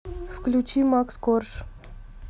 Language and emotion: Russian, neutral